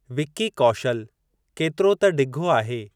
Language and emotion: Sindhi, neutral